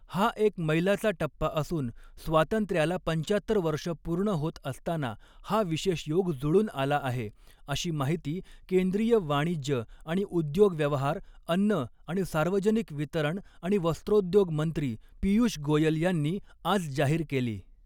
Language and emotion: Marathi, neutral